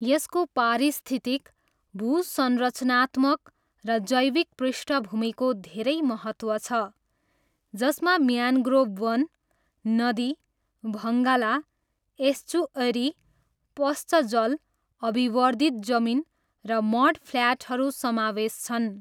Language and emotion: Nepali, neutral